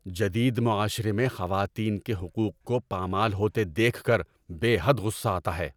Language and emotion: Urdu, angry